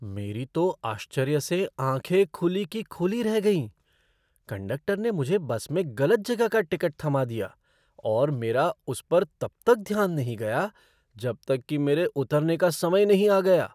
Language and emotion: Hindi, surprised